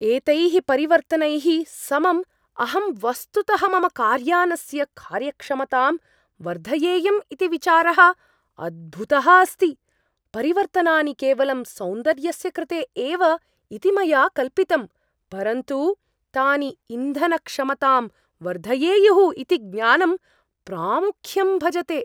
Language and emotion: Sanskrit, surprised